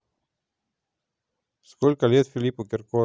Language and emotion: Russian, neutral